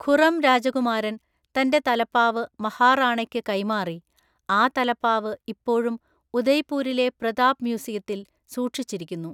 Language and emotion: Malayalam, neutral